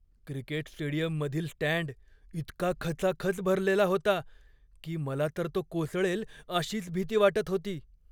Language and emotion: Marathi, fearful